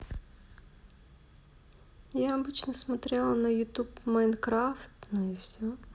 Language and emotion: Russian, neutral